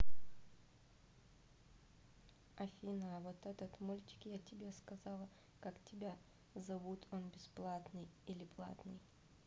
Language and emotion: Russian, neutral